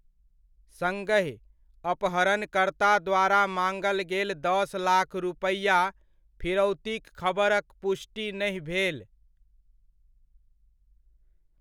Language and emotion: Maithili, neutral